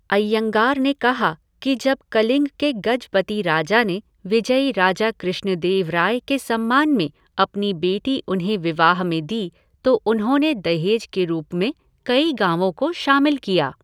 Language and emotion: Hindi, neutral